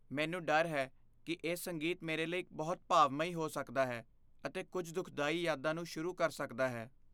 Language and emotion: Punjabi, fearful